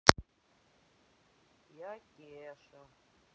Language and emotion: Russian, sad